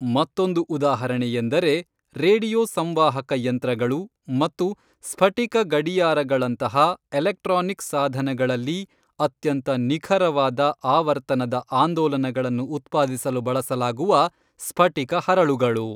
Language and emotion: Kannada, neutral